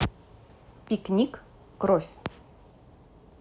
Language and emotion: Russian, neutral